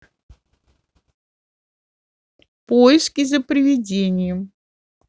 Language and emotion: Russian, neutral